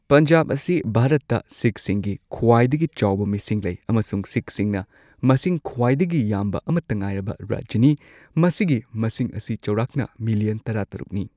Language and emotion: Manipuri, neutral